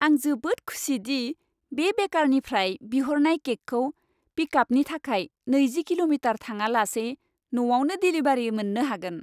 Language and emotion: Bodo, happy